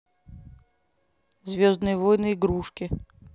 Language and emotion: Russian, neutral